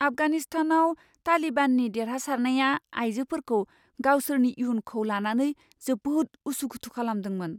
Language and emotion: Bodo, fearful